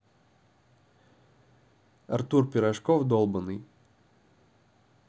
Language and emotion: Russian, neutral